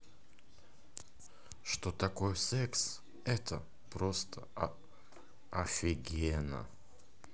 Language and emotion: Russian, positive